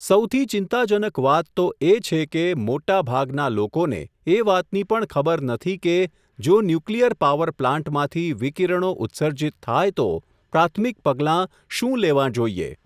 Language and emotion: Gujarati, neutral